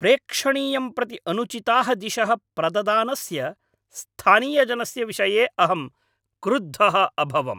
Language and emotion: Sanskrit, angry